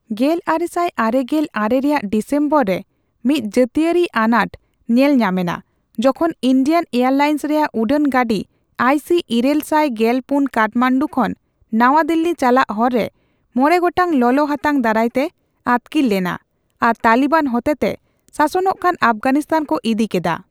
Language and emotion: Santali, neutral